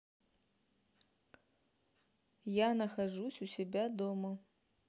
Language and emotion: Russian, neutral